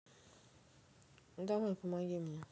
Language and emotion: Russian, neutral